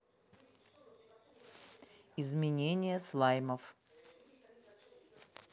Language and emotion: Russian, neutral